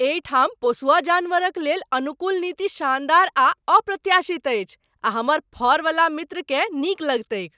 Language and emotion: Maithili, surprised